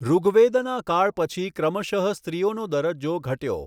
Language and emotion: Gujarati, neutral